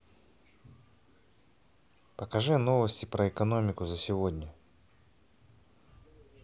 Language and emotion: Russian, neutral